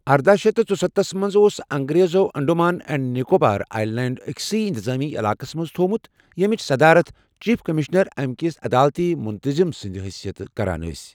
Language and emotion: Kashmiri, neutral